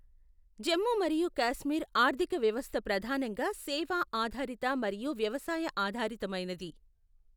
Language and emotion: Telugu, neutral